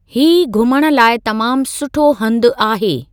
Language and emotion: Sindhi, neutral